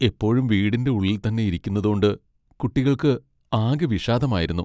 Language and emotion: Malayalam, sad